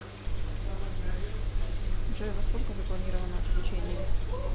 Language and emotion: Russian, neutral